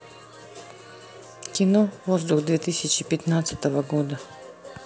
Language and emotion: Russian, neutral